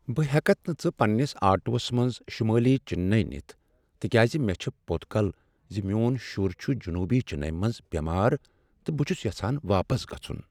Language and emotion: Kashmiri, sad